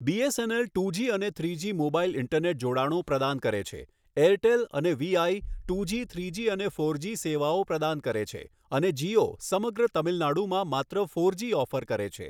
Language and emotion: Gujarati, neutral